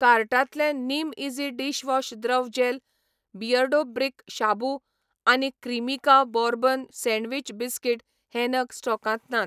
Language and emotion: Goan Konkani, neutral